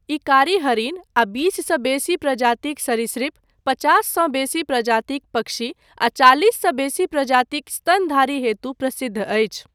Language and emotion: Maithili, neutral